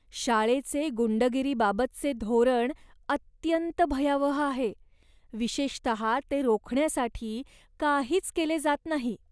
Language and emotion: Marathi, disgusted